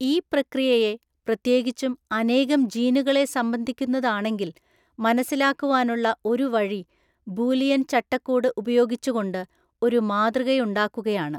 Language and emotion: Malayalam, neutral